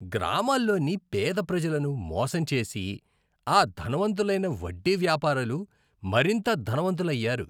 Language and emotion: Telugu, disgusted